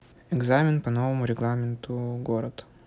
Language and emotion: Russian, neutral